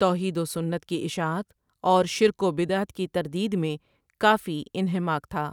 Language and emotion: Urdu, neutral